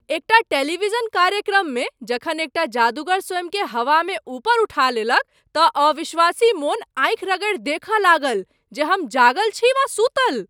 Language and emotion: Maithili, surprised